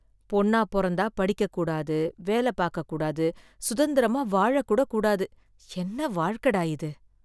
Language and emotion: Tamil, sad